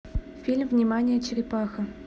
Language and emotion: Russian, neutral